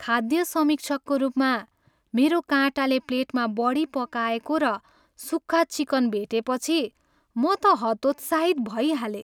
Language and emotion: Nepali, sad